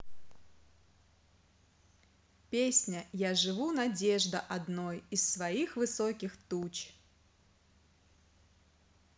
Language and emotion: Russian, positive